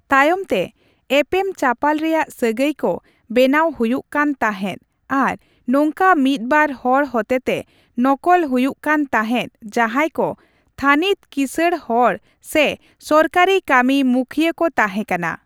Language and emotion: Santali, neutral